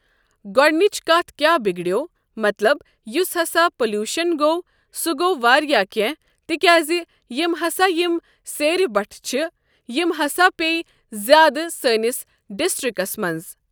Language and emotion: Kashmiri, neutral